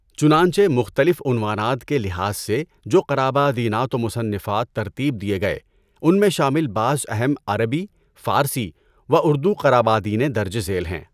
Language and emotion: Urdu, neutral